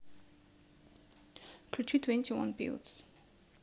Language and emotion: Russian, neutral